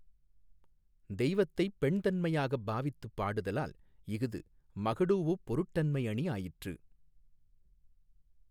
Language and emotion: Tamil, neutral